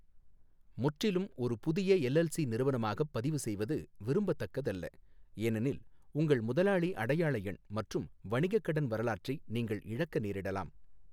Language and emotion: Tamil, neutral